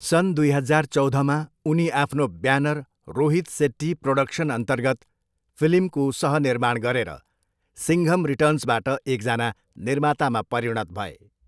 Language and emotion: Nepali, neutral